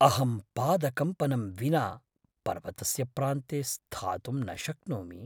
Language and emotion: Sanskrit, fearful